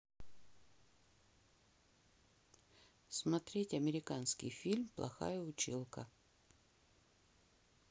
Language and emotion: Russian, neutral